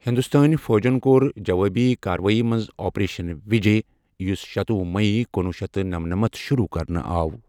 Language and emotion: Kashmiri, neutral